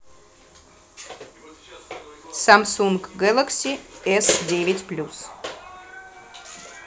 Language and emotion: Russian, neutral